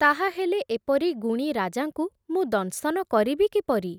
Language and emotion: Odia, neutral